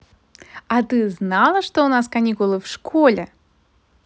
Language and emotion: Russian, positive